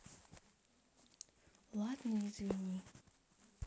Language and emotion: Russian, neutral